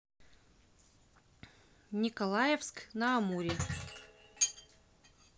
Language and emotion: Russian, neutral